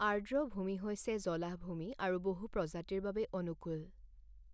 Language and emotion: Assamese, neutral